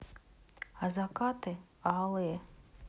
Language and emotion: Russian, neutral